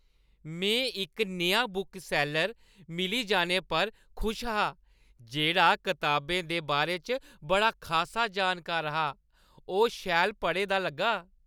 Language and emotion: Dogri, happy